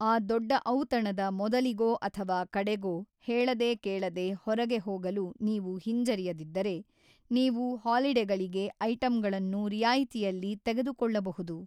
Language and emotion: Kannada, neutral